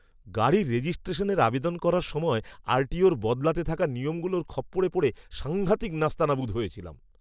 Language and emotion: Bengali, angry